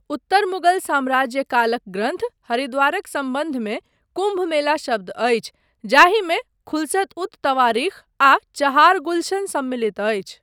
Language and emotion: Maithili, neutral